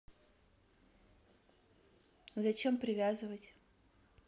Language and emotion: Russian, neutral